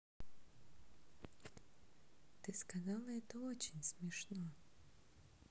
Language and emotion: Russian, neutral